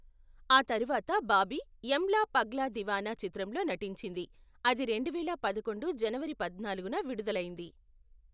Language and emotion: Telugu, neutral